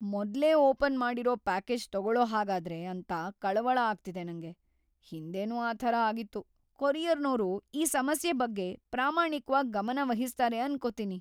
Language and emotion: Kannada, fearful